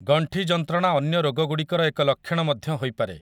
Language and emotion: Odia, neutral